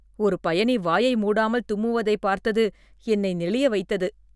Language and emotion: Tamil, disgusted